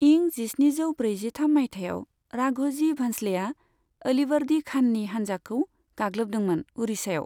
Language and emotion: Bodo, neutral